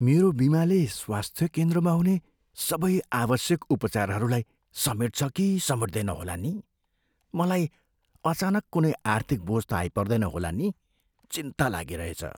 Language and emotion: Nepali, fearful